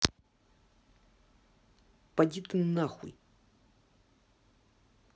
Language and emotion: Russian, angry